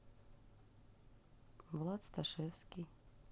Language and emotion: Russian, neutral